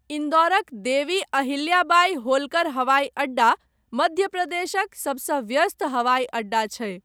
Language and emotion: Maithili, neutral